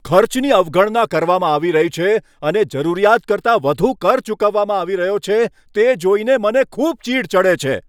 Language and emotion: Gujarati, angry